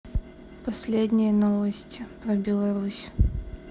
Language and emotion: Russian, neutral